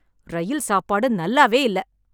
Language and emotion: Tamil, angry